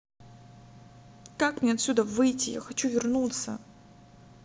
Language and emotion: Russian, angry